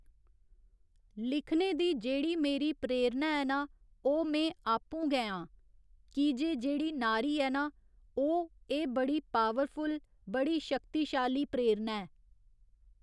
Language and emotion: Dogri, neutral